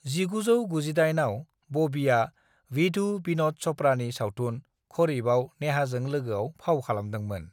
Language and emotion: Bodo, neutral